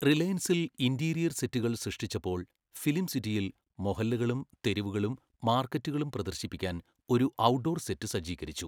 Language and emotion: Malayalam, neutral